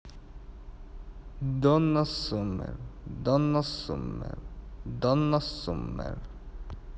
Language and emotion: Russian, neutral